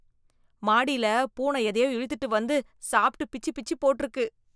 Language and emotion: Tamil, disgusted